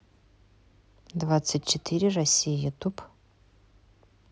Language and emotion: Russian, neutral